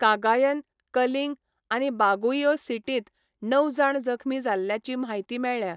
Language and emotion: Goan Konkani, neutral